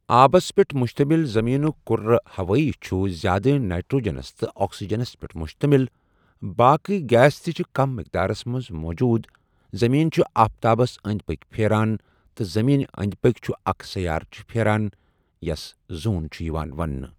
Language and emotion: Kashmiri, neutral